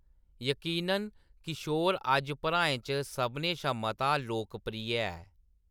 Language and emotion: Dogri, neutral